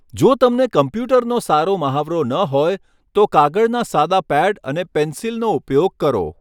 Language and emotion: Gujarati, neutral